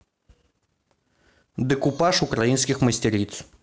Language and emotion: Russian, neutral